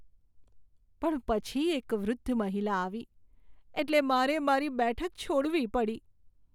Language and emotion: Gujarati, sad